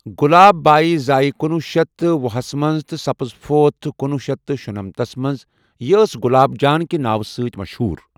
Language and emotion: Kashmiri, neutral